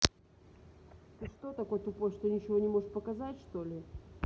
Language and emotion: Russian, angry